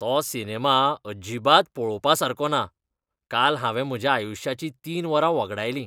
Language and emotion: Goan Konkani, disgusted